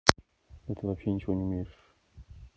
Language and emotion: Russian, neutral